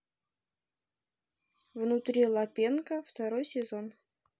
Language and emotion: Russian, neutral